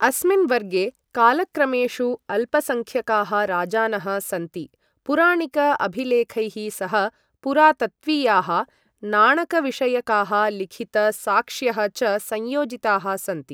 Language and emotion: Sanskrit, neutral